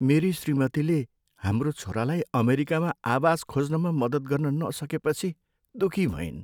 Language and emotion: Nepali, sad